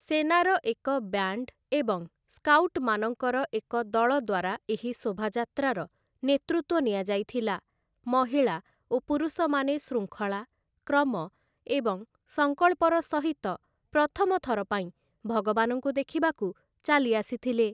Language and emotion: Odia, neutral